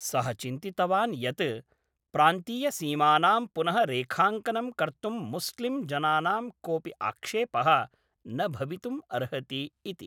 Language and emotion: Sanskrit, neutral